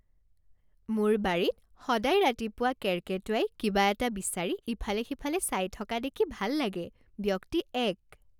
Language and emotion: Assamese, happy